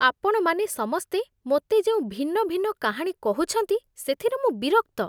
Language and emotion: Odia, disgusted